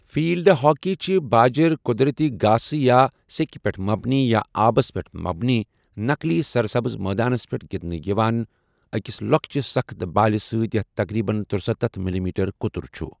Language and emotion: Kashmiri, neutral